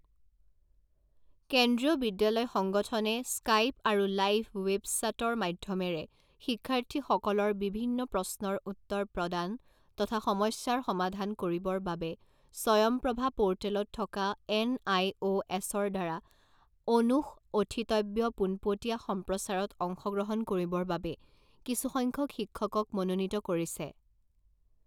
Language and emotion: Assamese, neutral